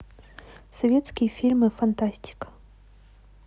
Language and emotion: Russian, neutral